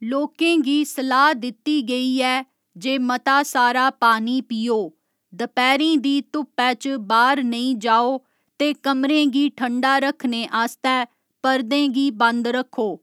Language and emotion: Dogri, neutral